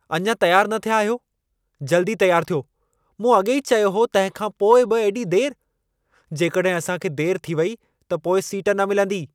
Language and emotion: Sindhi, angry